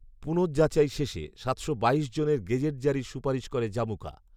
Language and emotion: Bengali, neutral